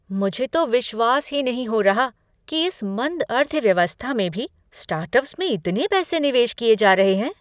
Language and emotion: Hindi, surprised